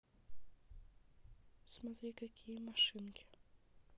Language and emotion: Russian, neutral